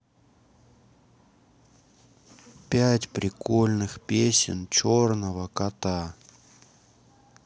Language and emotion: Russian, neutral